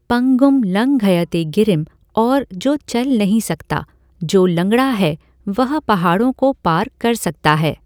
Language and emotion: Hindi, neutral